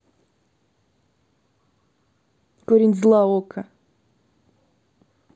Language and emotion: Russian, angry